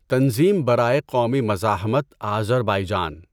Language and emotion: Urdu, neutral